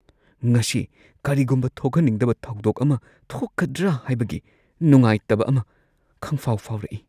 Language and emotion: Manipuri, fearful